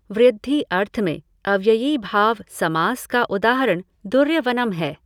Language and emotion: Hindi, neutral